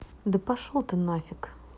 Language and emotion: Russian, angry